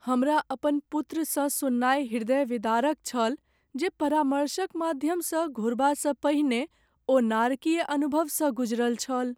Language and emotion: Maithili, sad